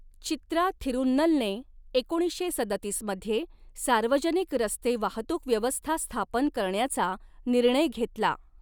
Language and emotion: Marathi, neutral